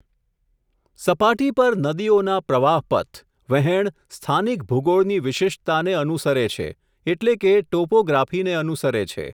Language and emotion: Gujarati, neutral